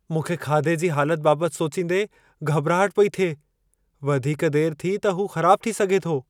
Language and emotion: Sindhi, fearful